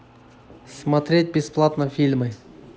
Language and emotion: Russian, neutral